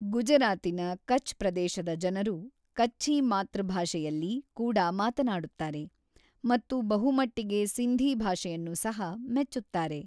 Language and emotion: Kannada, neutral